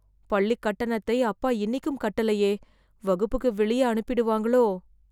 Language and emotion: Tamil, fearful